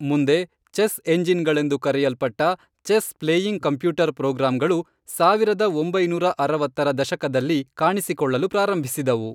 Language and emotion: Kannada, neutral